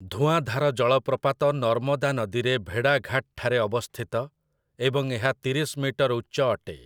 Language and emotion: Odia, neutral